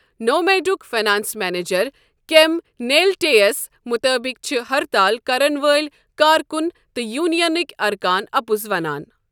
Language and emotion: Kashmiri, neutral